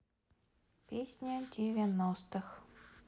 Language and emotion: Russian, sad